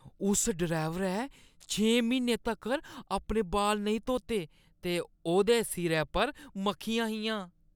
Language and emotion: Dogri, disgusted